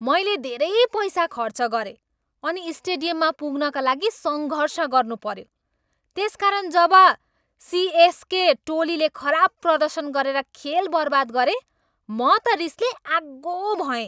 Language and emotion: Nepali, angry